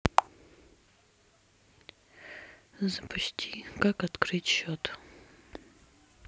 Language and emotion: Russian, sad